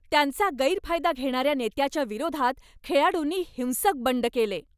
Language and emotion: Marathi, angry